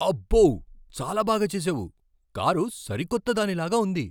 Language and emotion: Telugu, surprised